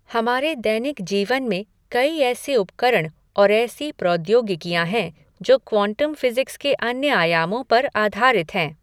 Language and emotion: Hindi, neutral